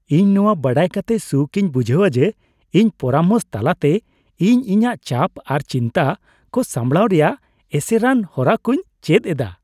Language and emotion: Santali, happy